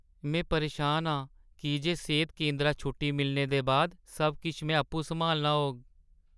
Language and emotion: Dogri, sad